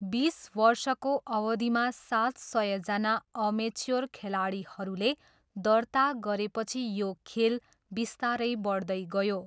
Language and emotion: Nepali, neutral